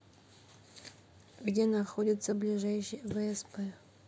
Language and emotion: Russian, neutral